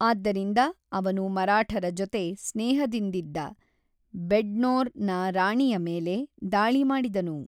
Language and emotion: Kannada, neutral